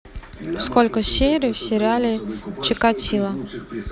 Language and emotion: Russian, neutral